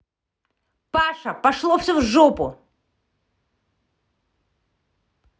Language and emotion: Russian, angry